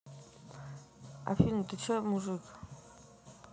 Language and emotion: Russian, neutral